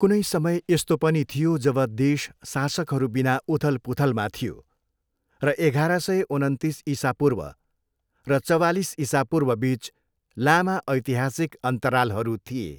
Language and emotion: Nepali, neutral